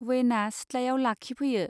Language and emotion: Bodo, neutral